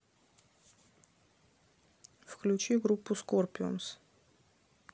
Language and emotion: Russian, neutral